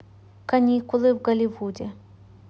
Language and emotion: Russian, neutral